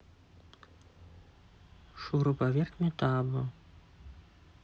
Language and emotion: Russian, neutral